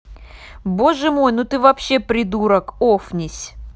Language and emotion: Russian, angry